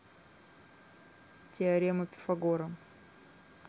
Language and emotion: Russian, neutral